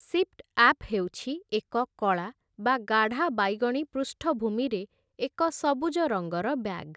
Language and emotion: Odia, neutral